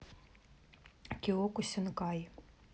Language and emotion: Russian, neutral